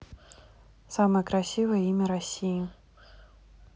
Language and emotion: Russian, neutral